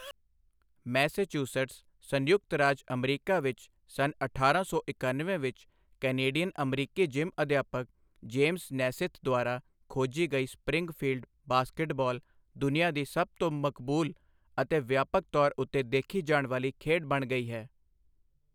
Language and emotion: Punjabi, neutral